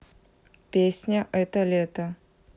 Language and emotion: Russian, neutral